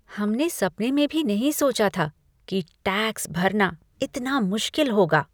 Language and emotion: Hindi, disgusted